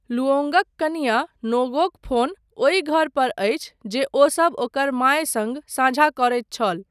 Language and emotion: Maithili, neutral